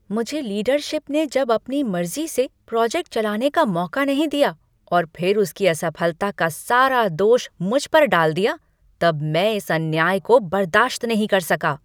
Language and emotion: Hindi, angry